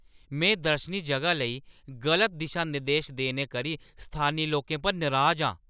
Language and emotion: Dogri, angry